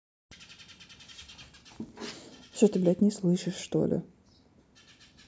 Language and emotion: Russian, angry